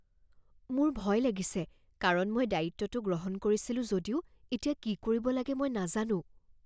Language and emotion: Assamese, fearful